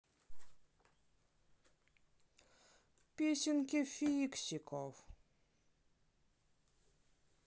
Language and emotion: Russian, sad